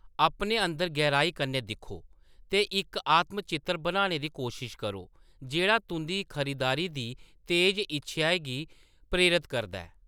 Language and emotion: Dogri, neutral